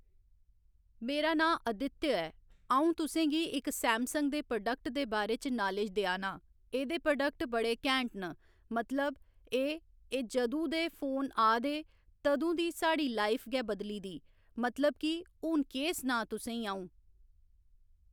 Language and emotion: Dogri, neutral